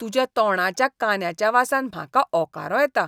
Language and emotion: Goan Konkani, disgusted